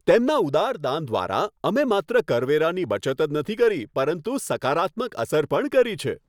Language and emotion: Gujarati, happy